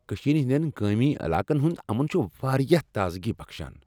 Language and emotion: Kashmiri, happy